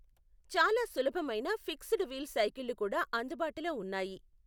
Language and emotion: Telugu, neutral